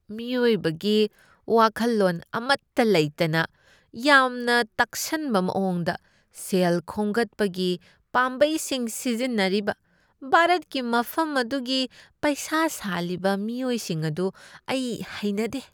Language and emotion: Manipuri, disgusted